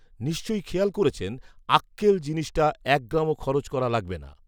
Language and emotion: Bengali, neutral